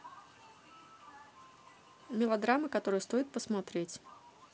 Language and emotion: Russian, neutral